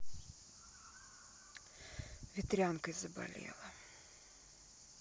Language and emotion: Russian, sad